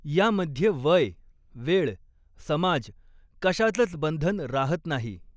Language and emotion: Marathi, neutral